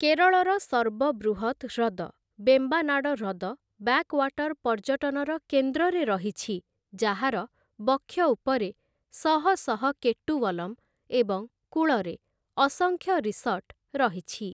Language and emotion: Odia, neutral